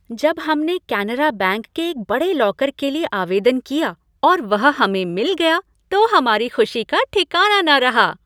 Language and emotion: Hindi, happy